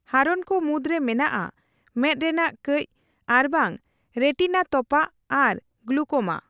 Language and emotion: Santali, neutral